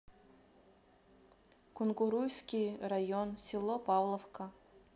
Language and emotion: Russian, neutral